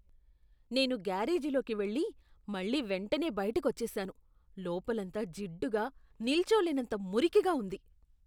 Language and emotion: Telugu, disgusted